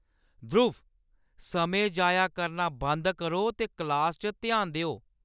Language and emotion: Dogri, angry